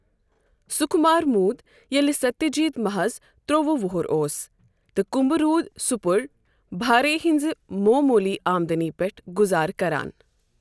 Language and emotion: Kashmiri, neutral